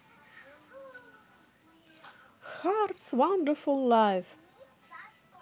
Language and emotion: Russian, positive